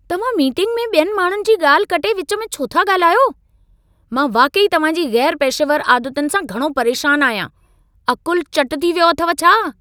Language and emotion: Sindhi, angry